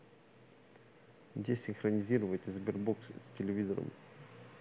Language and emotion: Russian, neutral